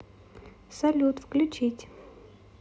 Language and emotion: Russian, positive